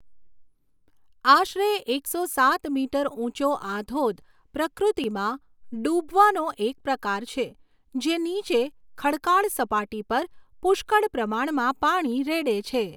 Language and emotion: Gujarati, neutral